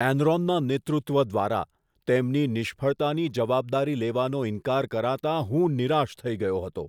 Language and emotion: Gujarati, disgusted